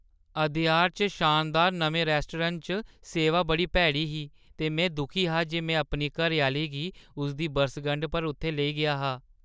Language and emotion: Dogri, sad